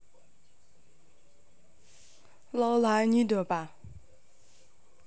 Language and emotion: Russian, neutral